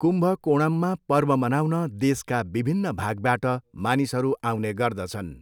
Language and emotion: Nepali, neutral